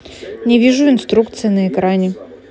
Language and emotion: Russian, angry